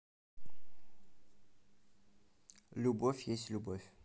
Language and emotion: Russian, neutral